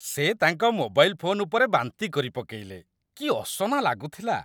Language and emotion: Odia, disgusted